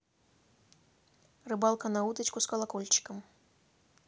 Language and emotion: Russian, neutral